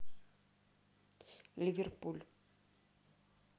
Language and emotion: Russian, neutral